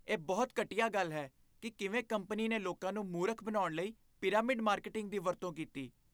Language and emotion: Punjabi, disgusted